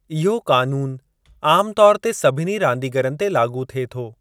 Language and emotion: Sindhi, neutral